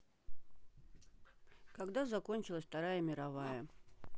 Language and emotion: Russian, neutral